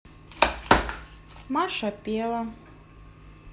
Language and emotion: Russian, neutral